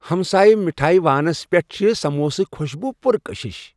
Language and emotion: Kashmiri, happy